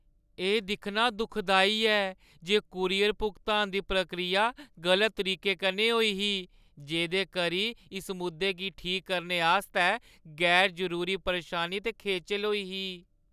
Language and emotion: Dogri, sad